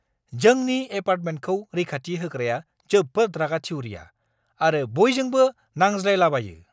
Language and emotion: Bodo, angry